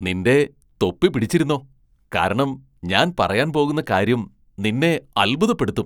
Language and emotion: Malayalam, surprised